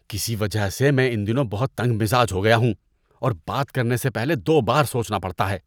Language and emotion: Urdu, disgusted